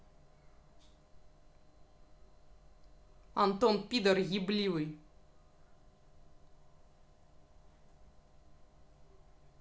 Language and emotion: Russian, angry